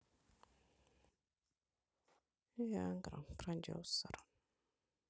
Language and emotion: Russian, sad